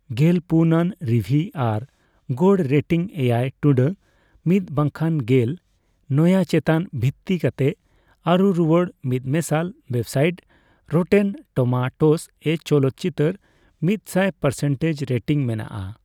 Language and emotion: Santali, neutral